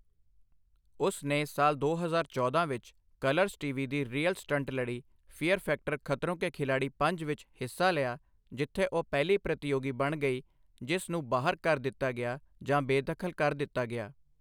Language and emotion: Punjabi, neutral